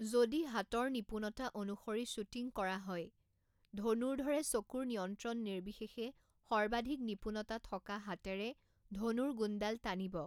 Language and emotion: Assamese, neutral